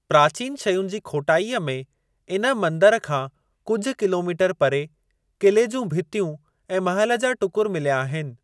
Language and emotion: Sindhi, neutral